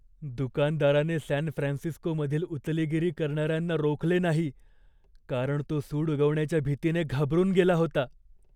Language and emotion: Marathi, fearful